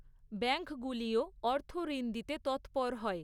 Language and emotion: Bengali, neutral